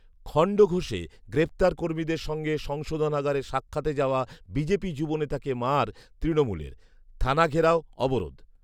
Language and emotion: Bengali, neutral